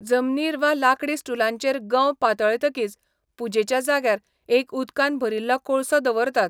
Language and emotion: Goan Konkani, neutral